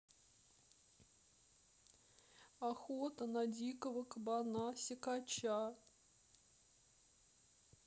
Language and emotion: Russian, sad